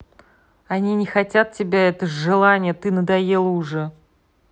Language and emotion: Russian, angry